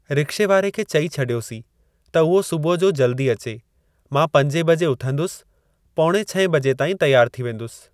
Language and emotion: Sindhi, neutral